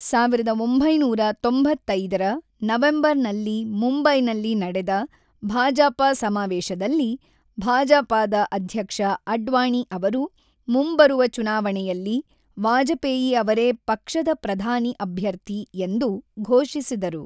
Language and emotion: Kannada, neutral